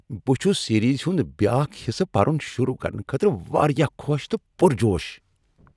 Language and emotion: Kashmiri, happy